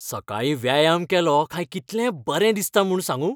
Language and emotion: Goan Konkani, happy